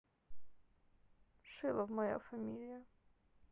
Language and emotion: Russian, sad